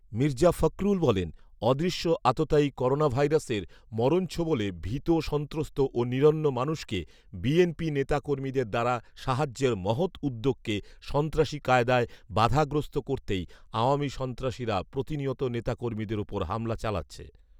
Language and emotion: Bengali, neutral